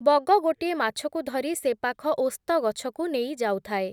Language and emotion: Odia, neutral